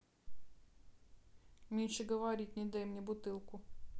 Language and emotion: Russian, neutral